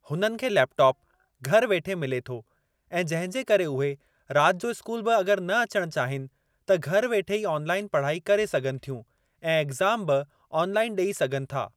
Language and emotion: Sindhi, neutral